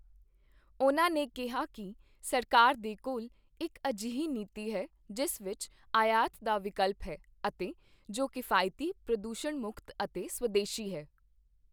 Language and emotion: Punjabi, neutral